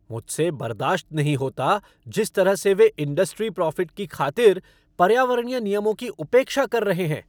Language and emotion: Hindi, angry